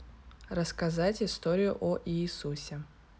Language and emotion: Russian, neutral